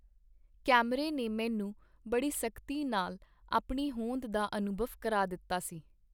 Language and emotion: Punjabi, neutral